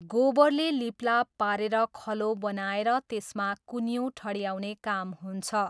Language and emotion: Nepali, neutral